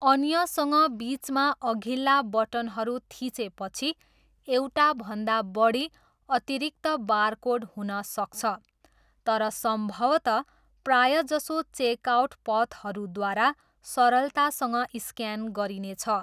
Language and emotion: Nepali, neutral